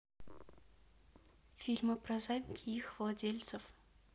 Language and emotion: Russian, neutral